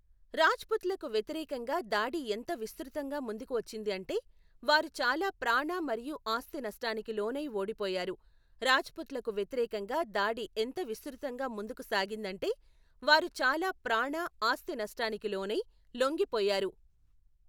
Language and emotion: Telugu, neutral